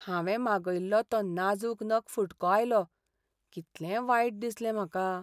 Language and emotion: Goan Konkani, sad